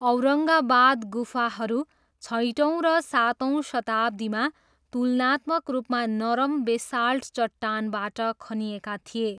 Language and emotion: Nepali, neutral